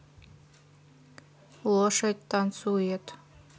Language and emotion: Russian, neutral